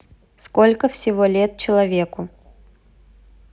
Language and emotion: Russian, neutral